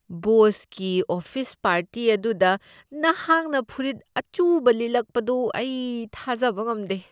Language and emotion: Manipuri, disgusted